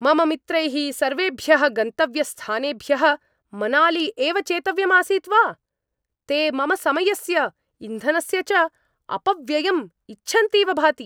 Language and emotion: Sanskrit, angry